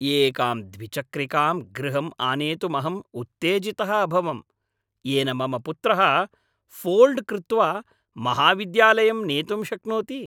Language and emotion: Sanskrit, happy